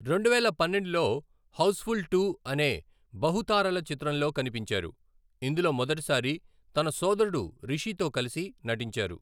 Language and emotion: Telugu, neutral